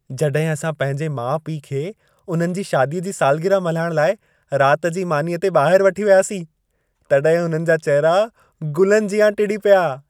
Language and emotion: Sindhi, happy